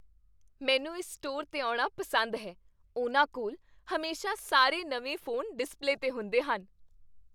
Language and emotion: Punjabi, happy